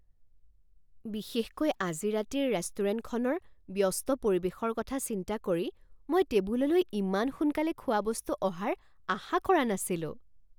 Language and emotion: Assamese, surprised